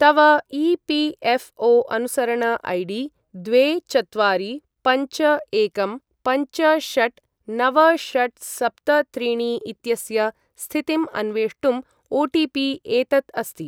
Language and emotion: Sanskrit, neutral